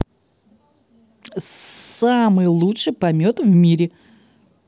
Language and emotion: Russian, positive